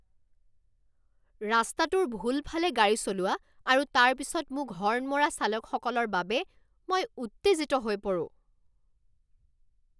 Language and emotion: Assamese, angry